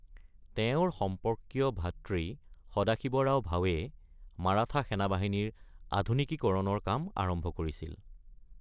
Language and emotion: Assamese, neutral